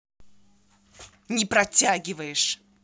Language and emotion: Russian, angry